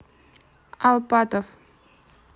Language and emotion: Russian, neutral